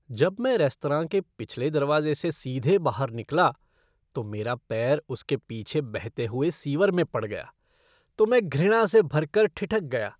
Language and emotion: Hindi, disgusted